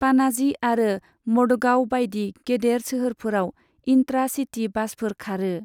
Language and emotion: Bodo, neutral